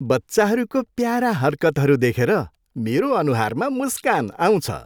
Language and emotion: Nepali, happy